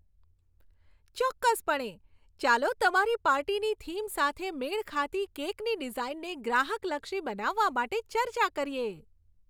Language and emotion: Gujarati, happy